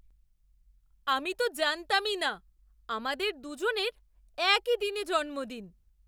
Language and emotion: Bengali, surprised